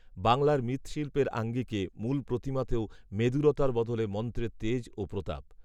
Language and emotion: Bengali, neutral